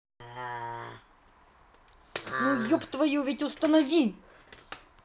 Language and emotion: Russian, angry